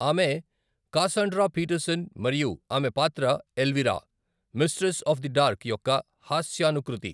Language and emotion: Telugu, neutral